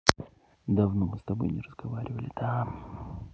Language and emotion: Russian, neutral